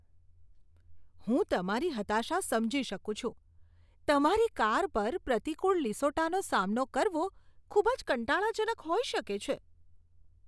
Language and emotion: Gujarati, disgusted